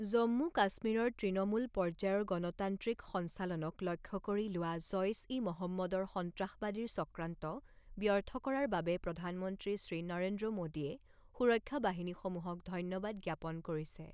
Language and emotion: Assamese, neutral